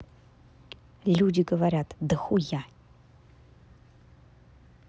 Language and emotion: Russian, angry